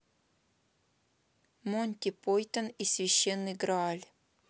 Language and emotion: Russian, neutral